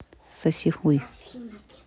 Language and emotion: Russian, neutral